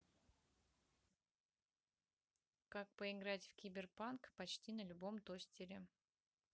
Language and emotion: Russian, neutral